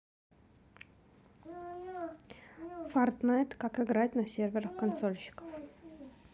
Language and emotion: Russian, neutral